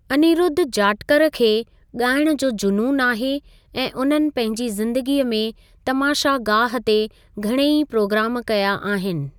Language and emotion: Sindhi, neutral